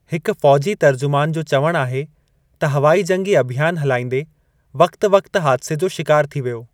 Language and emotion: Sindhi, neutral